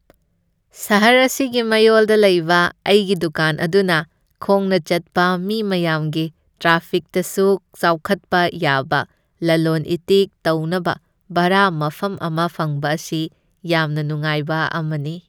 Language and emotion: Manipuri, happy